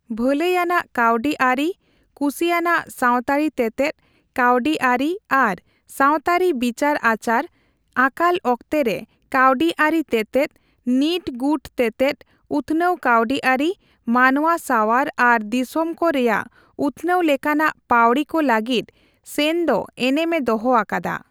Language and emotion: Santali, neutral